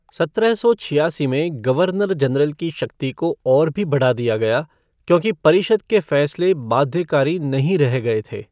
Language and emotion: Hindi, neutral